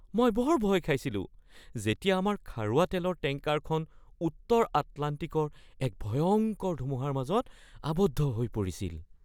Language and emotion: Assamese, fearful